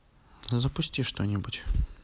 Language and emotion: Russian, neutral